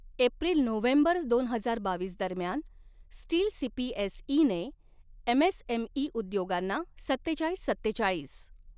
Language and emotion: Marathi, neutral